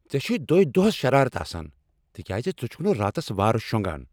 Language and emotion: Kashmiri, angry